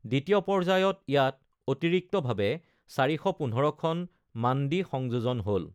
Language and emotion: Assamese, neutral